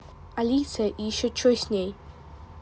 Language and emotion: Russian, neutral